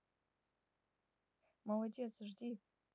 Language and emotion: Russian, neutral